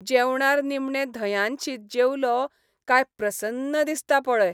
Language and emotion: Goan Konkani, happy